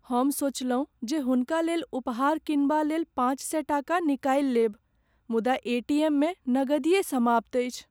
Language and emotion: Maithili, sad